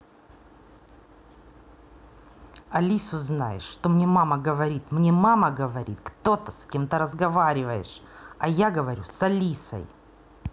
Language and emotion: Russian, angry